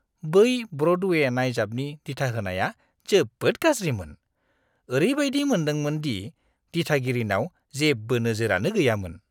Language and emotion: Bodo, disgusted